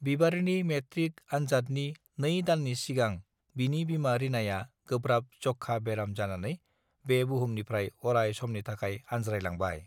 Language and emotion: Bodo, neutral